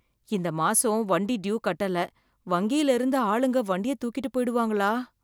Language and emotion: Tamil, fearful